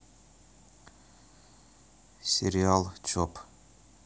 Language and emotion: Russian, neutral